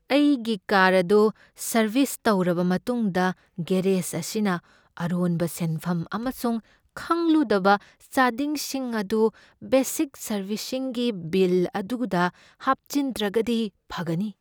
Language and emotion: Manipuri, fearful